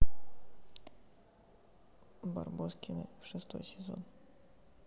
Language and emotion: Russian, neutral